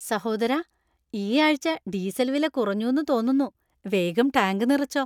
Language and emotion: Malayalam, happy